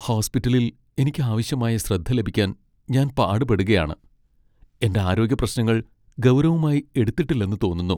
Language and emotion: Malayalam, sad